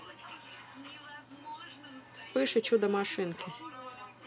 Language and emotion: Russian, neutral